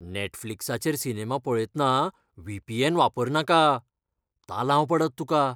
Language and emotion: Goan Konkani, fearful